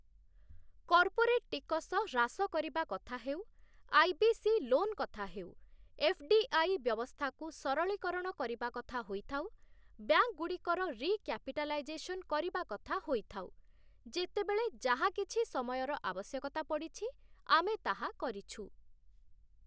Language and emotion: Odia, neutral